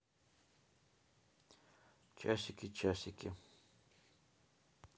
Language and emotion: Russian, neutral